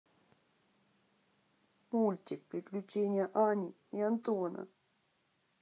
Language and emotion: Russian, sad